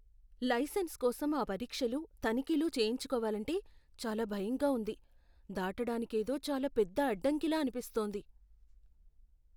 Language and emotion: Telugu, fearful